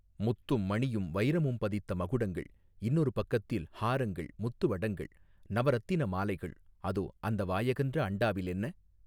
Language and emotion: Tamil, neutral